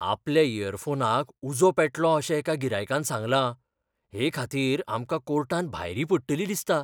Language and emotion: Goan Konkani, fearful